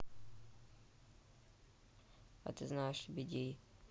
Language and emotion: Russian, neutral